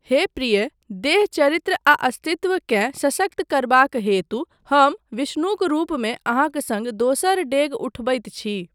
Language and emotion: Maithili, neutral